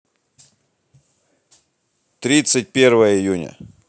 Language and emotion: Russian, neutral